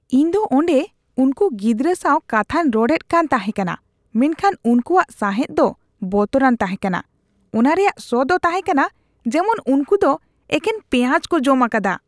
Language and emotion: Santali, disgusted